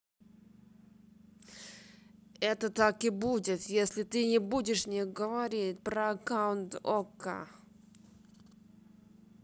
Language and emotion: Russian, angry